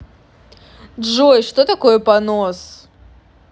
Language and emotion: Russian, neutral